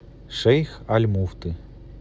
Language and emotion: Russian, neutral